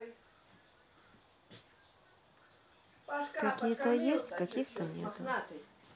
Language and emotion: Russian, neutral